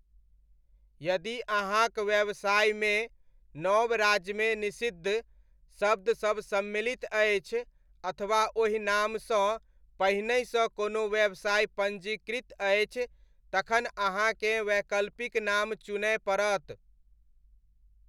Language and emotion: Maithili, neutral